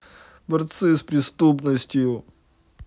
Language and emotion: Russian, sad